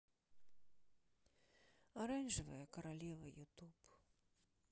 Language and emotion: Russian, sad